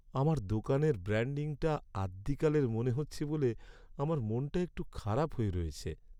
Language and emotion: Bengali, sad